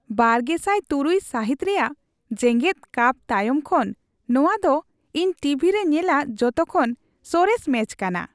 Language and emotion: Santali, happy